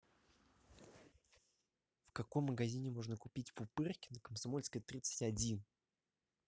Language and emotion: Russian, neutral